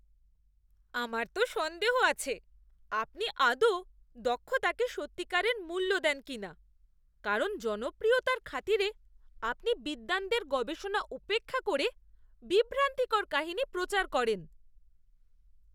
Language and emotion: Bengali, disgusted